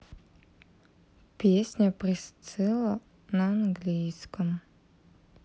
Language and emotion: Russian, neutral